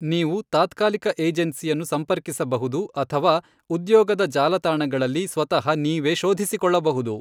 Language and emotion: Kannada, neutral